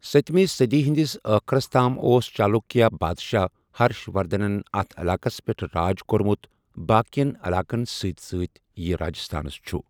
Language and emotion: Kashmiri, neutral